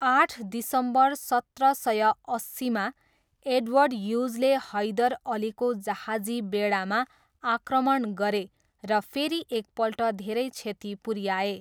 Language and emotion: Nepali, neutral